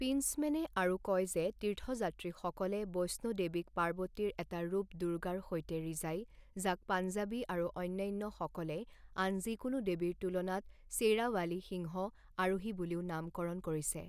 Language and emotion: Assamese, neutral